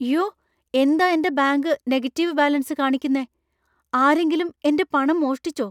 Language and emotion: Malayalam, fearful